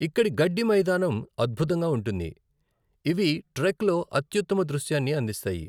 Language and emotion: Telugu, neutral